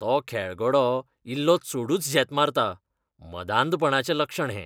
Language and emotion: Goan Konkani, disgusted